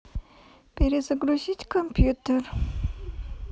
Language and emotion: Russian, neutral